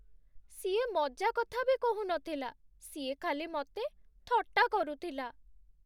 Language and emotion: Odia, sad